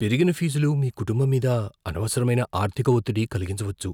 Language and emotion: Telugu, fearful